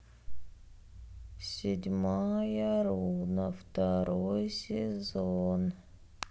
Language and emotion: Russian, neutral